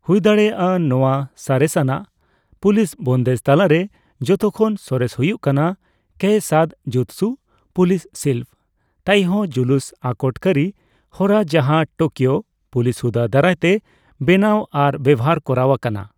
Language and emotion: Santali, neutral